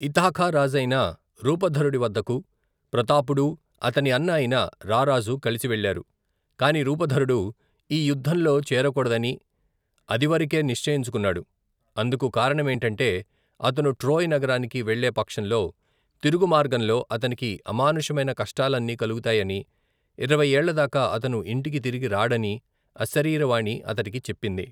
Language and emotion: Telugu, neutral